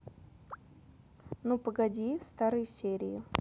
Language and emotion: Russian, neutral